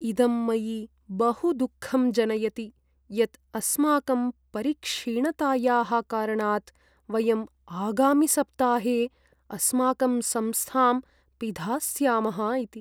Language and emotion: Sanskrit, sad